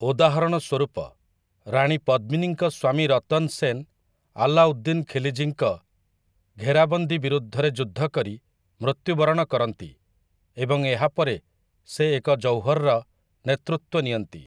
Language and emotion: Odia, neutral